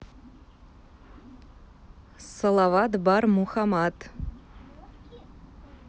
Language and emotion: Russian, neutral